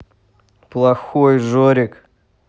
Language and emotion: Russian, neutral